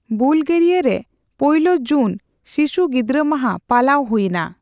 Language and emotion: Santali, neutral